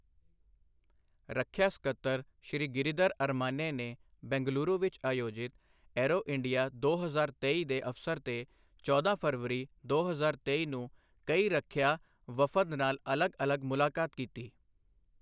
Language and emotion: Punjabi, neutral